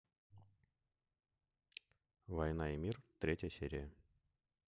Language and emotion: Russian, neutral